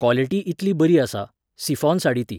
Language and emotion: Goan Konkani, neutral